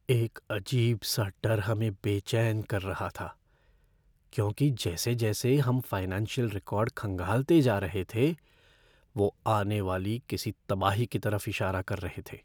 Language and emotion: Hindi, fearful